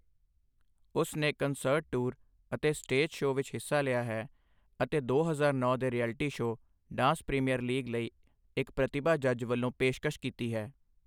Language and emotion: Punjabi, neutral